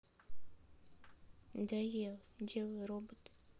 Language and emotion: Russian, sad